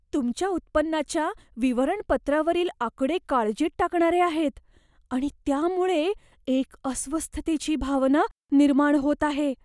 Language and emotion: Marathi, fearful